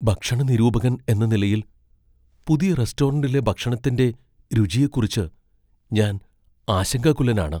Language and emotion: Malayalam, fearful